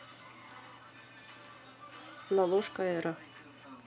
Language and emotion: Russian, neutral